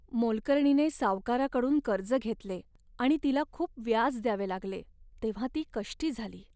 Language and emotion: Marathi, sad